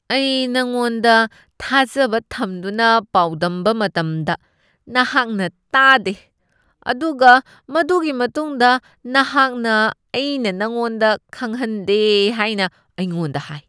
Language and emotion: Manipuri, disgusted